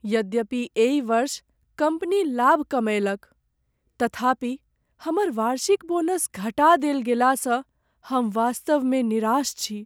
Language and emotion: Maithili, sad